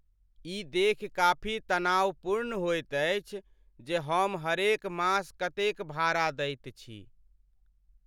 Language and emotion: Maithili, sad